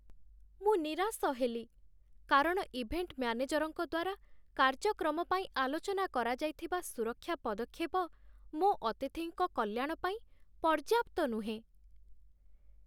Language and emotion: Odia, sad